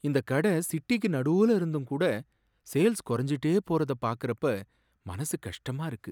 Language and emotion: Tamil, sad